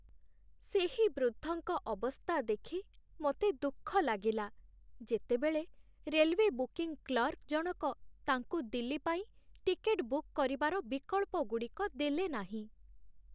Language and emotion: Odia, sad